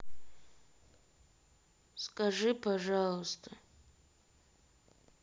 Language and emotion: Russian, sad